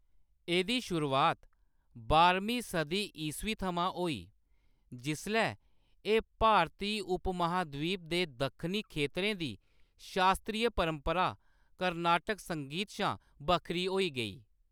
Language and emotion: Dogri, neutral